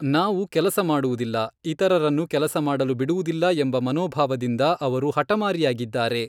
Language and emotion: Kannada, neutral